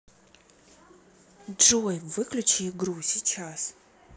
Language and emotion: Russian, angry